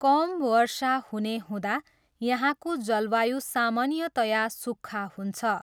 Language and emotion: Nepali, neutral